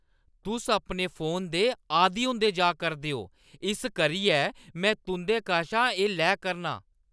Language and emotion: Dogri, angry